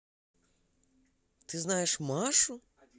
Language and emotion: Russian, positive